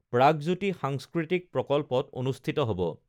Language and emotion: Assamese, neutral